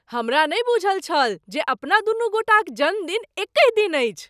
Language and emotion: Maithili, surprised